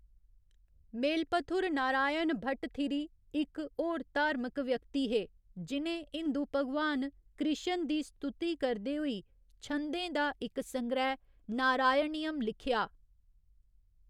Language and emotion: Dogri, neutral